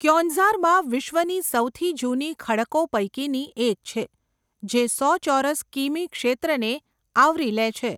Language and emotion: Gujarati, neutral